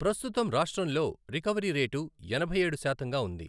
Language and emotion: Telugu, neutral